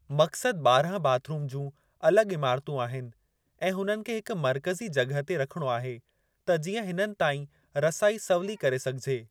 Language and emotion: Sindhi, neutral